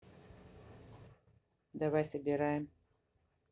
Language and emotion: Russian, neutral